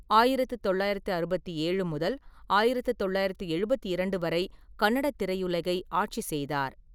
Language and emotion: Tamil, neutral